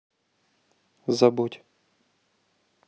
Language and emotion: Russian, neutral